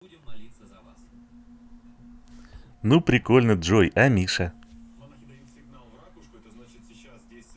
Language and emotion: Russian, positive